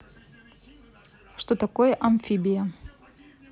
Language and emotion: Russian, neutral